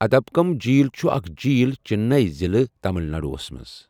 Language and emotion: Kashmiri, neutral